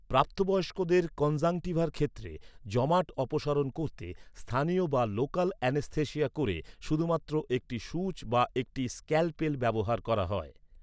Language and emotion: Bengali, neutral